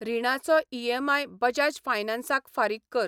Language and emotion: Goan Konkani, neutral